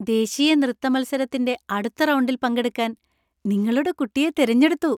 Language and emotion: Malayalam, happy